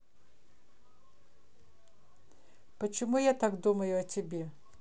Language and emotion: Russian, neutral